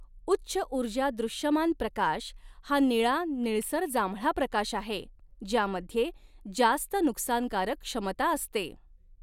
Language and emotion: Marathi, neutral